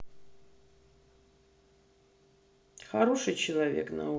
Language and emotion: Russian, sad